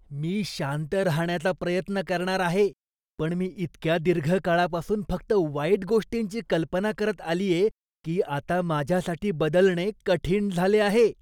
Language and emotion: Marathi, disgusted